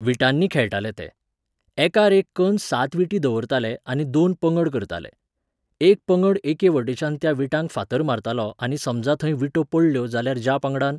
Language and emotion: Goan Konkani, neutral